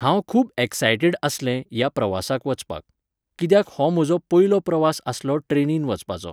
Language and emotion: Goan Konkani, neutral